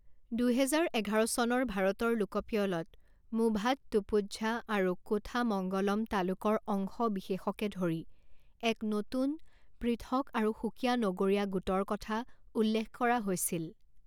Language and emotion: Assamese, neutral